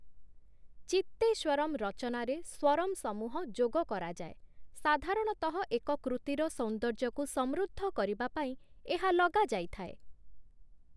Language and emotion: Odia, neutral